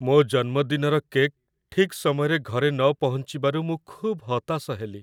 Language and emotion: Odia, sad